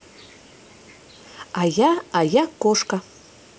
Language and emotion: Russian, positive